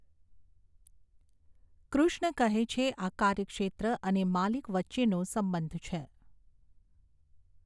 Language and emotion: Gujarati, neutral